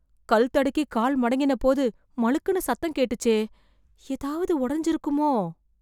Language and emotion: Tamil, fearful